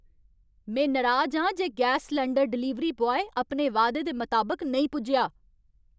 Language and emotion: Dogri, angry